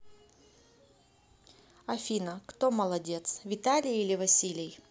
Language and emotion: Russian, neutral